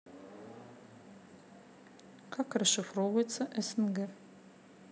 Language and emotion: Russian, neutral